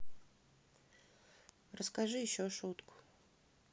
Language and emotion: Russian, neutral